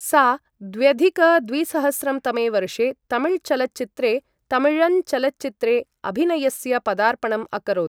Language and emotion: Sanskrit, neutral